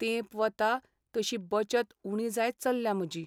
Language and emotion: Goan Konkani, sad